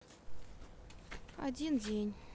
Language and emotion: Russian, neutral